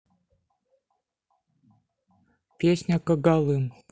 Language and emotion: Russian, neutral